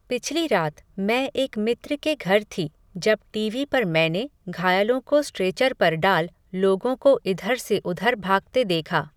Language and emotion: Hindi, neutral